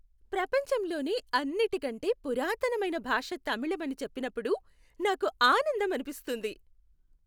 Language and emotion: Telugu, happy